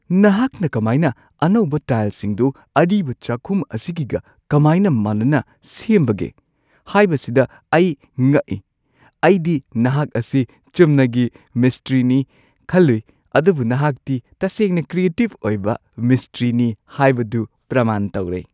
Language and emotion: Manipuri, surprised